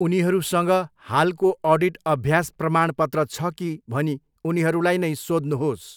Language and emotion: Nepali, neutral